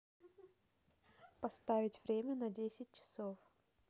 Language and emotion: Russian, neutral